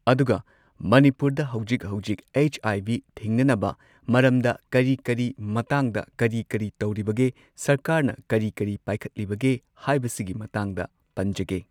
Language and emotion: Manipuri, neutral